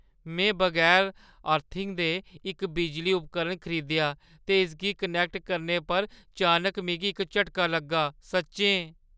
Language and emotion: Dogri, fearful